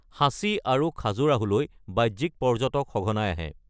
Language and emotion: Assamese, neutral